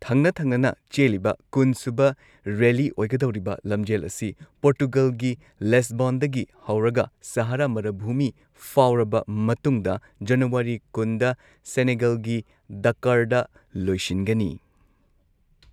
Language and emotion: Manipuri, neutral